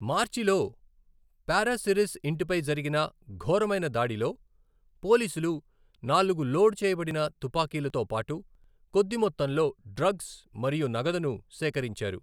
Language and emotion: Telugu, neutral